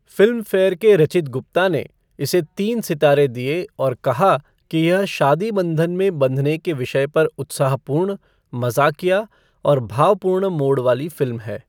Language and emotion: Hindi, neutral